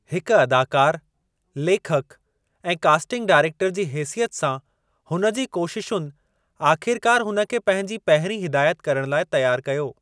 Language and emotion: Sindhi, neutral